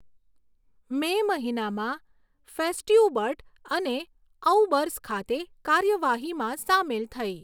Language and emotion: Gujarati, neutral